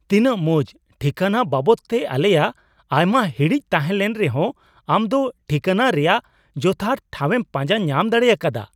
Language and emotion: Santali, surprised